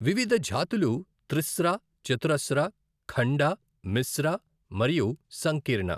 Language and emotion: Telugu, neutral